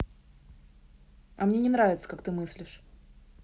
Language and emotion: Russian, angry